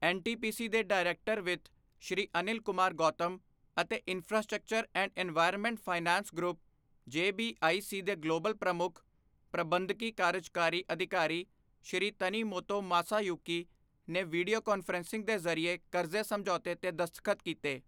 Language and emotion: Punjabi, neutral